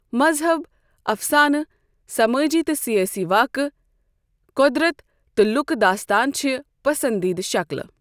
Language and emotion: Kashmiri, neutral